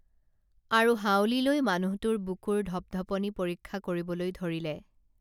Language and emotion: Assamese, neutral